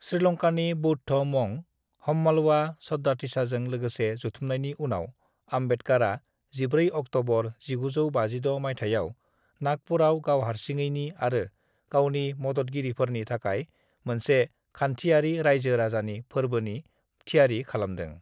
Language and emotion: Bodo, neutral